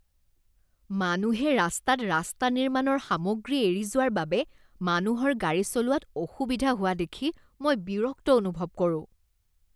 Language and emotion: Assamese, disgusted